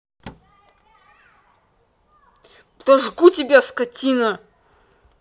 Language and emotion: Russian, angry